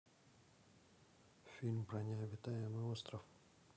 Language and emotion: Russian, neutral